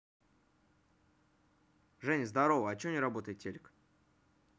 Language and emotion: Russian, neutral